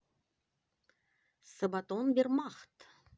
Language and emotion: Russian, positive